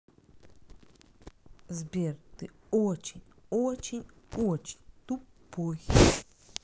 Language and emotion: Russian, neutral